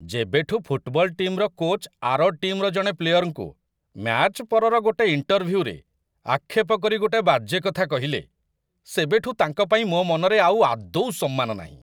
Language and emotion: Odia, disgusted